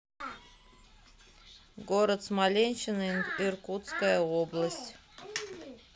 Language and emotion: Russian, neutral